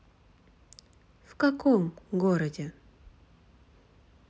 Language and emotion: Russian, neutral